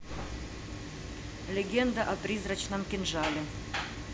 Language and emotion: Russian, neutral